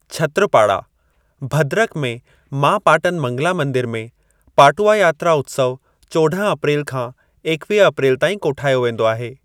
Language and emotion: Sindhi, neutral